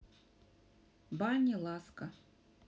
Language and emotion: Russian, neutral